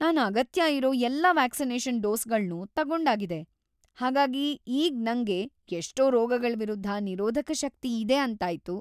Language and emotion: Kannada, happy